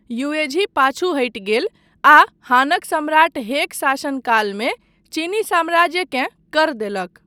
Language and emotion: Maithili, neutral